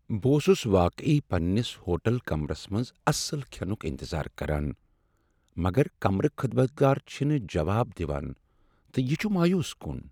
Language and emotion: Kashmiri, sad